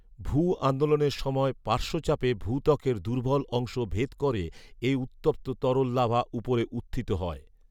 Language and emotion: Bengali, neutral